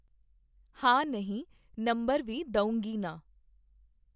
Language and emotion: Punjabi, neutral